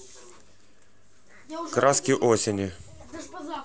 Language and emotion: Russian, neutral